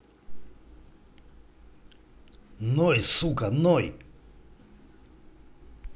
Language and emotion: Russian, angry